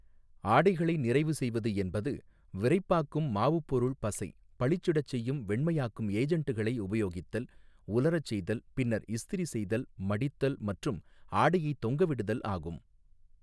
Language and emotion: Tamil, neutral